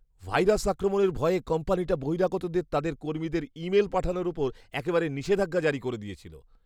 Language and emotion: Bengali, fearful